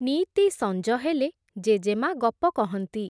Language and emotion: Odia, neutral